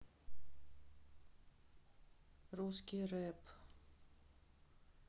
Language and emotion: Russian, neutral